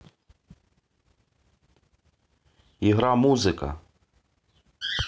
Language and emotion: Russian, neutral